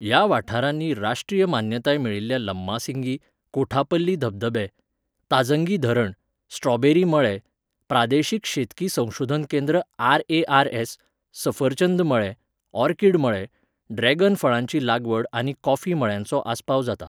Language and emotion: Goan Konkani, neutral